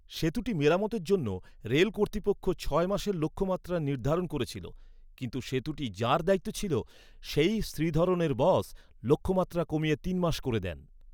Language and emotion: Bengali, neutral